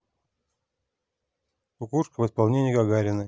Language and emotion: Russian, neutral